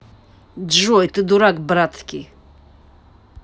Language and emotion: Russian, angry